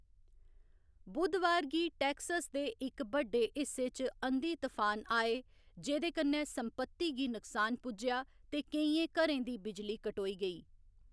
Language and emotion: Dogri, neutral